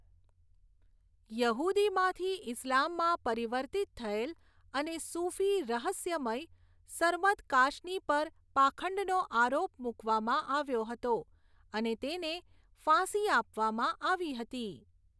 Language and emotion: Gujarati, neutral